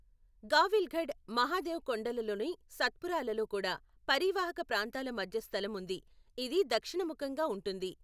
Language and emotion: Telugu, neutral